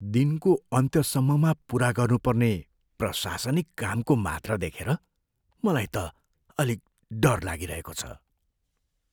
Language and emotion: Nepali, fearful